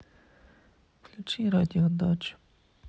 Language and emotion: Russian, sad